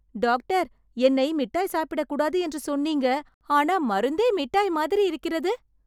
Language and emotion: Tamil, surprised